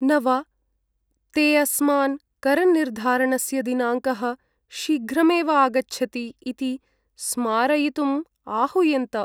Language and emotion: Sanskrit, sad